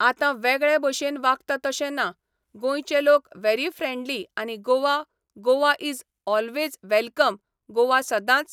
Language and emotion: Goan Konkani, neutral